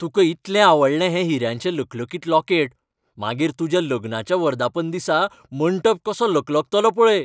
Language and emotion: Goan Konkani, happy